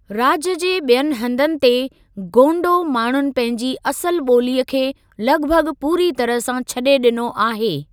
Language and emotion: Sindhi, neutral